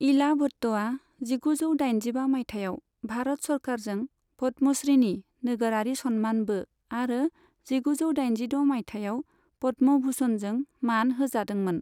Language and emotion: Bodo, neutral